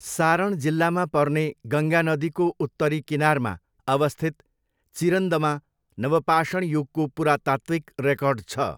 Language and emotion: Nepali, neutral